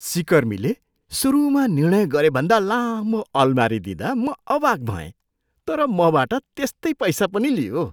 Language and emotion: Nepali, surprised